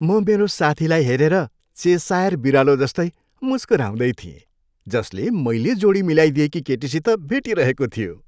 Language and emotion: Nepali, happy